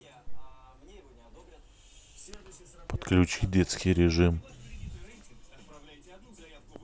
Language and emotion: Russian, neutral